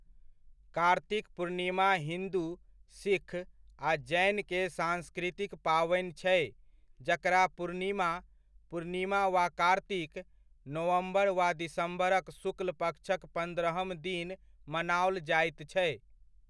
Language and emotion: Maithili, neutral